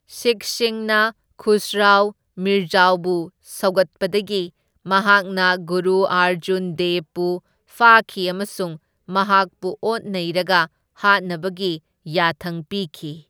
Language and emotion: Manipuri, neutral